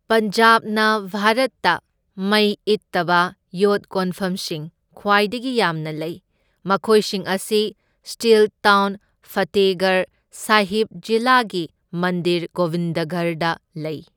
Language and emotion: Manipuri, neutral